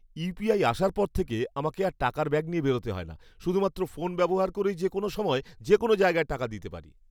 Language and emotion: Bengali, happy